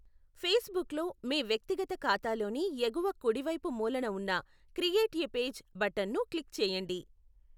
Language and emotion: Telugu, neutral